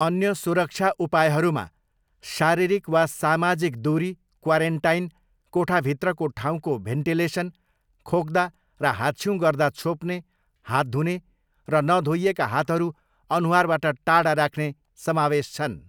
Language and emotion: Nepali, neutral